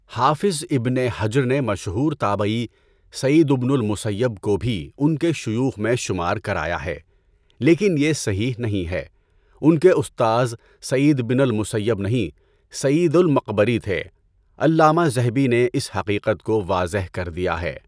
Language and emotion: Urdu, neutral